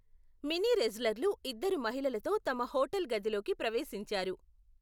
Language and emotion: Telugu, neutral